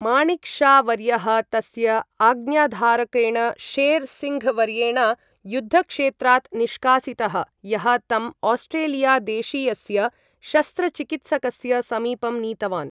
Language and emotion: Sanskrit, neutral